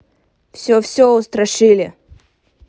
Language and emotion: Russian, neutral